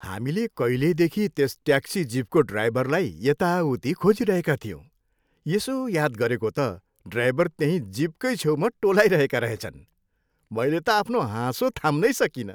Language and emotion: Nepali, happy